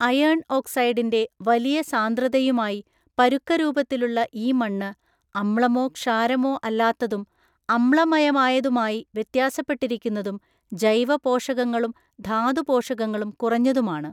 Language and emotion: Malayalam, neutral